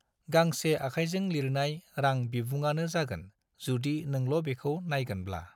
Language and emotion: Bodo, neutral